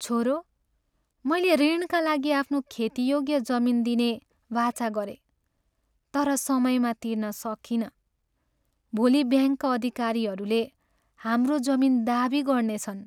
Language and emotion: Nepali, sad